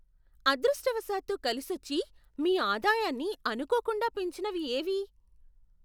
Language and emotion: Telugu, surprised